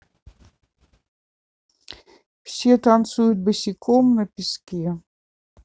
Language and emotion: Russian, neutral